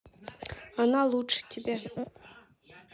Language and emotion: Russian, neutral